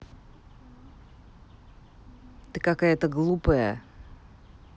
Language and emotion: Russian, angry